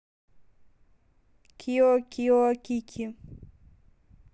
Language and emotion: Russian, neutral